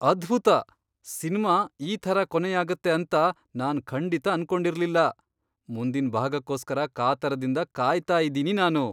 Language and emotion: Kannada, surprised